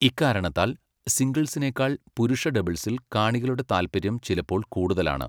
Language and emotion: Malayalam, neutral